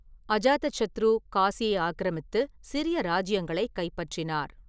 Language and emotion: Tamil, neutral